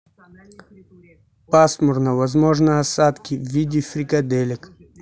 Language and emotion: Russian, neutral